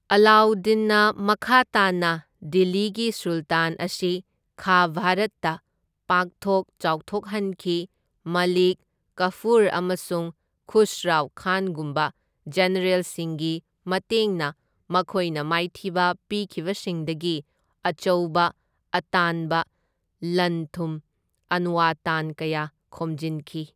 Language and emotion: Manipuri, neutral